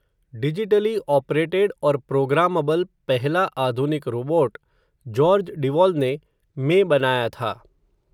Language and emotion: Hindi, neutral